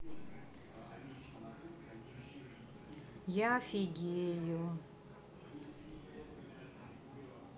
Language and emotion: Russian, neutral